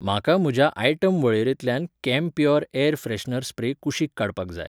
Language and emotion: Goan Konkani, neutral